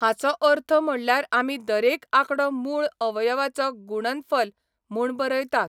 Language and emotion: Goan Konkani, neutral